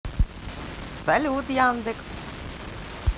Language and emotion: Russian, positive